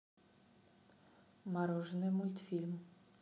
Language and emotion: Russian, neutral